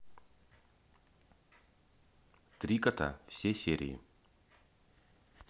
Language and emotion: Russian, neutral